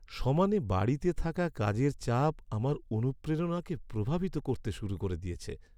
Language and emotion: Bengali, sad